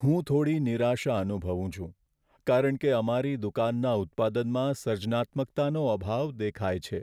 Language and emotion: Gujarati, sad